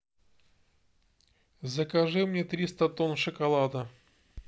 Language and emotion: Russian, neutral